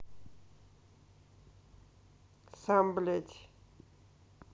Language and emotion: Russian, neutral